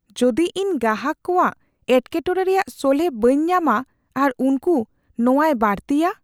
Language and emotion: Santali, fearful